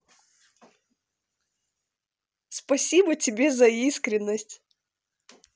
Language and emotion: Russian, positive